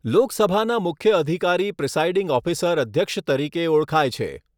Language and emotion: Gujarati, neutral